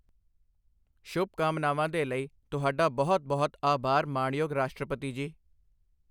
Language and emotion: Punjabi, neutral